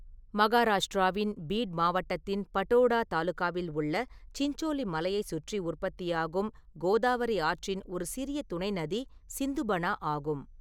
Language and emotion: Tamil, neutral